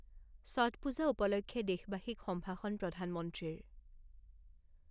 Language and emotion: Assamese, neutral